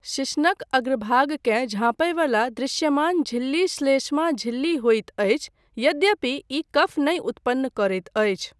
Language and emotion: Maithili, neutral